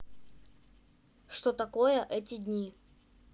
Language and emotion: Russian, neutral